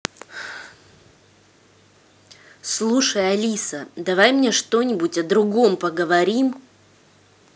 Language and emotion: Russian, angry